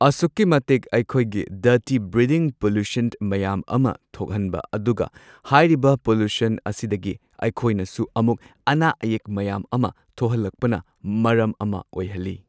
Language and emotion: Manipuri, neutral